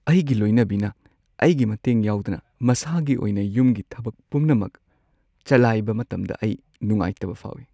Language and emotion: Manipuri, sad